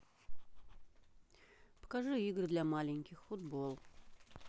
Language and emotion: Russian, neutral